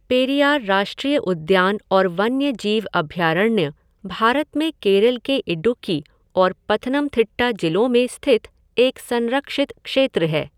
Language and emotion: Hindi, neutral